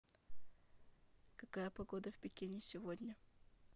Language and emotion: Russian, neutral